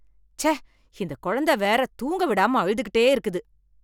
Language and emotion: Tamil, angry